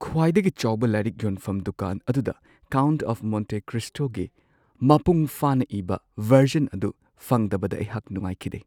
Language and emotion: Manipuri, sad